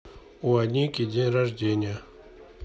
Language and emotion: Russian, neutral